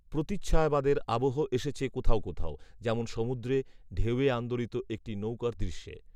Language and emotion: Bengali, neutral